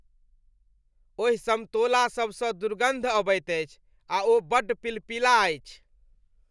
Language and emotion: Maithili, disgusted